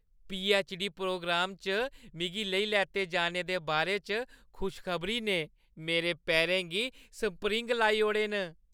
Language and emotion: Dogri, happy